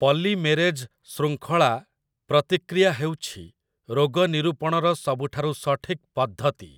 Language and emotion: Odia, neutral